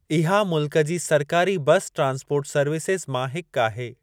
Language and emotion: Sindhi, neutral